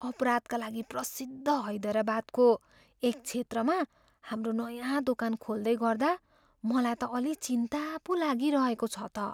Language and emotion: Nepali, fearful